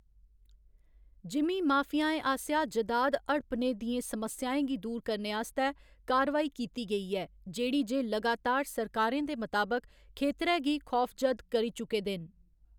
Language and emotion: Dogri, neutral